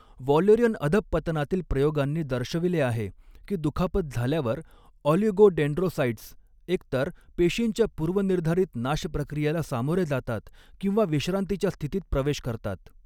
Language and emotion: Marathi, neutral